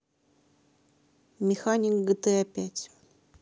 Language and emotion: Russian, neutral